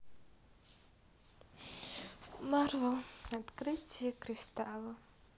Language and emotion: Russian, sad